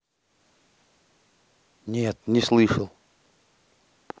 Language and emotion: Russian, neutral